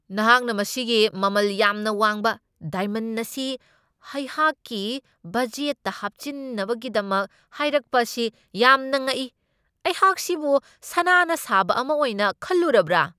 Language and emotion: Manipuri, angry